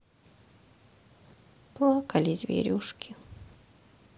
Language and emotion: Russian, sad